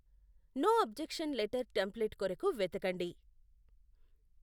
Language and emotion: Telugu, neutral